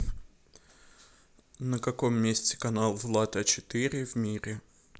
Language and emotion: Russian, neutral